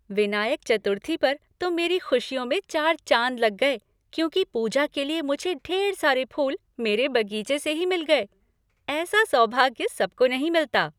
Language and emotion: Hindi, happy